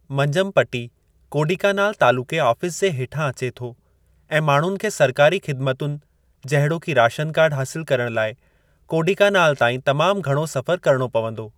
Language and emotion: Sindhi, neutral